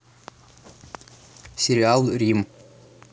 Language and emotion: Russian, neutral